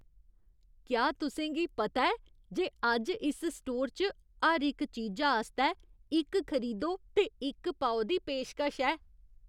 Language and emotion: Dogri, surprised